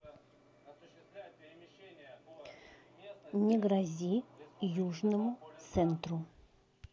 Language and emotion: Russian, neutral